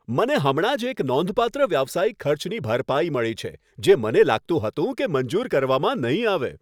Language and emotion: Gujarati, happy